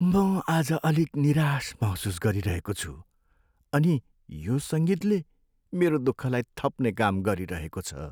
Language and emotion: Nepali, sad